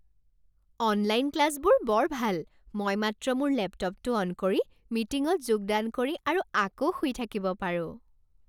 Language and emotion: Assamese, happy